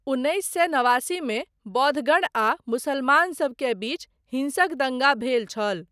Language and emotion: Maithili, neutral